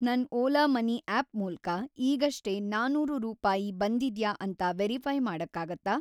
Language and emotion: Kannada, neutral